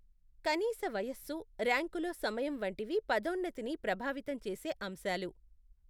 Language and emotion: Telugu, neutral